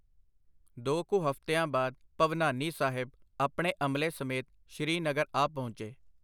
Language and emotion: Punjabi, neutral